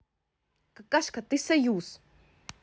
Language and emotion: Russian, angry